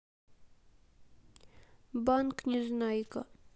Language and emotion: Russian, sad